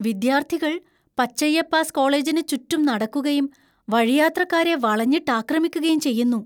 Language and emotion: Malayalam, fearful